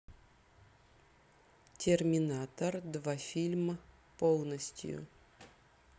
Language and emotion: Russian, neutral